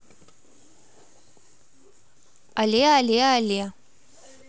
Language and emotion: Russian, positive